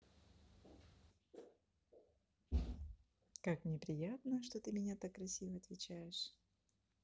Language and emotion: Russian, positive